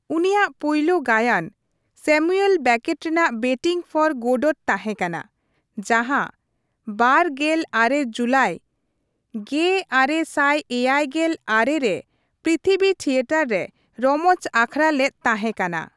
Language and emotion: Santali, neutral